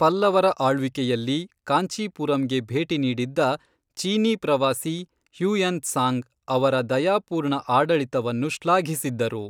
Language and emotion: Kannada, neutral